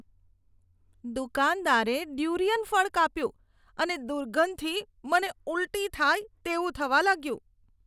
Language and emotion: Gujarati, disgusted